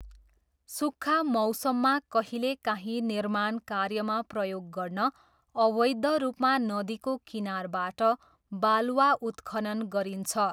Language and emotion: Nepali, neutral